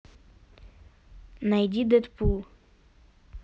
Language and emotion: Russian, neutral